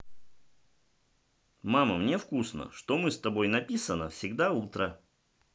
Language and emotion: Russian, positive